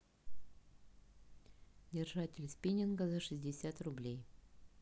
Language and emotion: Russian, neutral